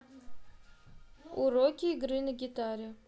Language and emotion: Russian, neutral